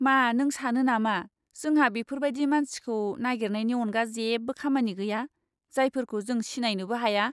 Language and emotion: Bodo, disgusted